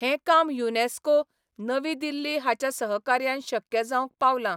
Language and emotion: Goan Konkani, neutral